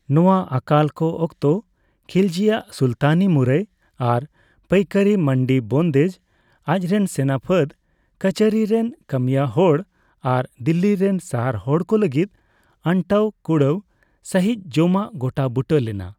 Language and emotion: Santali, neutral